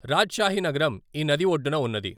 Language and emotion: Telugu, neutral